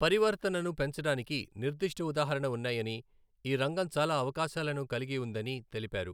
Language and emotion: Telugu, neutral